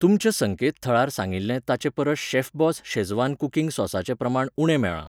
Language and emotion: Goan Konkani, neutral